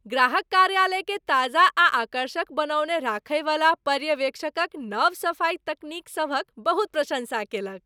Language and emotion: Maithili, happy